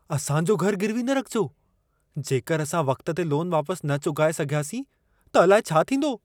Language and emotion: Sindhi, fearful